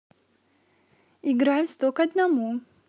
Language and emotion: Russian, positive